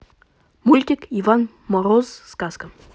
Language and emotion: Russian, neutral